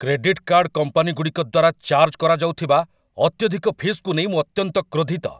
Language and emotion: Odia, angry